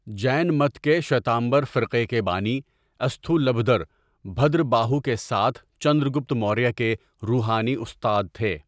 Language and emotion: Urdu, neutral